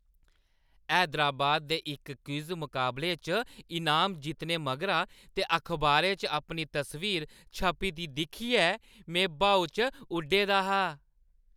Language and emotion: Dogri, happy